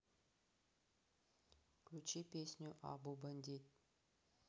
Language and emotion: Russian, neutral